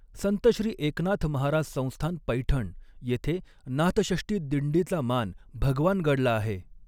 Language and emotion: Marathi, neutral